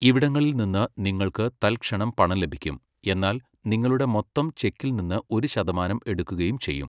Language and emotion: Malayalam, neutral